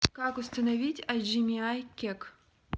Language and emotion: Russian, neutral